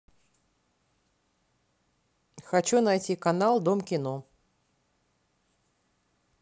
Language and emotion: Russian, neutral